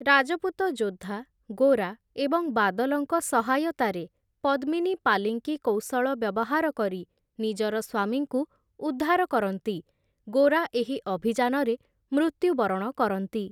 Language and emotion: Odia, neutral